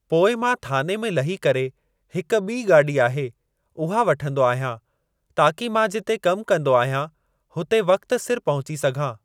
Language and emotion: Sindhi, neutral